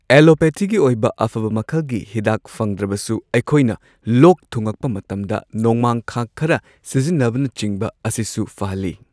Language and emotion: Manipuri, neutral